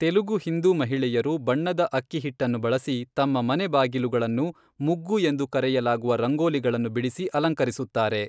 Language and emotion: Kannada, neutral